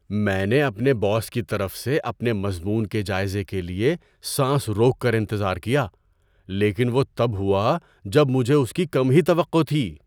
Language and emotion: Urdu, surprised